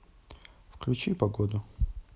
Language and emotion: Russian, neutral